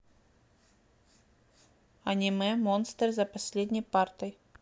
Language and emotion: Russian, neutral